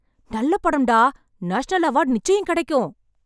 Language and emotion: Tamil, happy